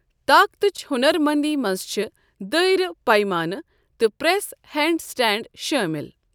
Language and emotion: Kashmiri, neutral